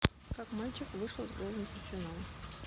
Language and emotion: Russian, neutral